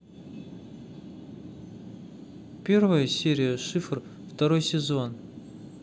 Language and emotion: Russian, neutral